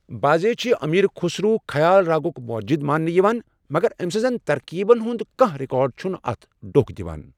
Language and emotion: Kashmiri, neutral